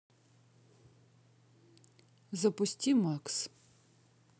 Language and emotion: Russian, neutral